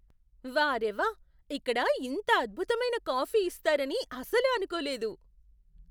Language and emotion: Telugu, surprised